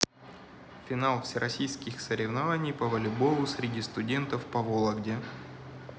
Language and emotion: Russian, neutral